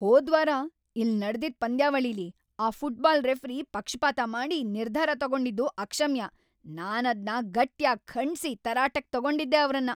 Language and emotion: Kannada, angry